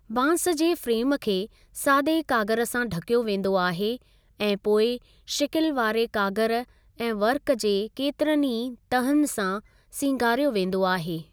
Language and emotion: Sindhi, neutral